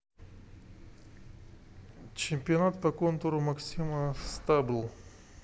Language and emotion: Russian, neutral